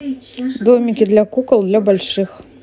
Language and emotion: Russian, neutral